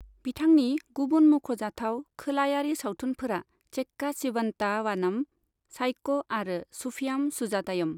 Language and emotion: Bodo, neutral